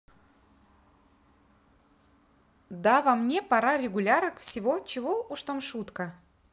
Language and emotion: Russian, neutral